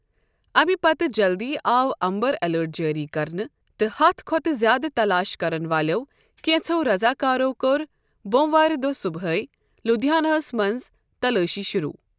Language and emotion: Kashmiri, neutral